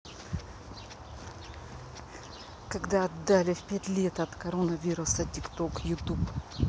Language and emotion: Russian, angry